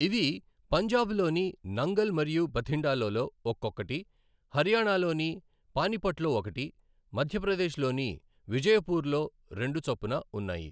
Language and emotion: Telugu, neutral